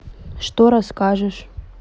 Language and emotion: Russian, neutral